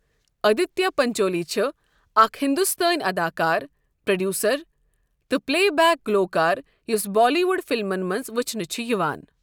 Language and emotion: Kashmiri, neutral